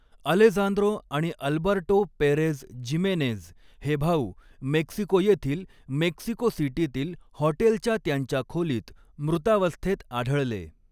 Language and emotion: Marathi, neutral